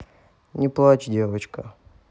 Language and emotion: Russian, neutral